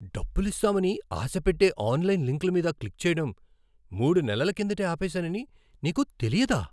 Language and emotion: Telugu, surprised